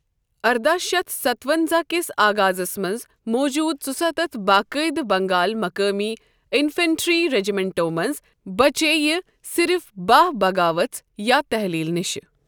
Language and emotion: Kashmiri, neutral